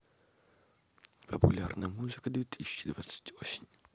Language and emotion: Russian, neutral